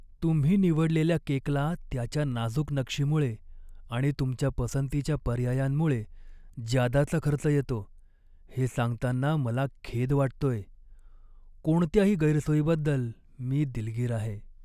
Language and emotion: Marathi, sad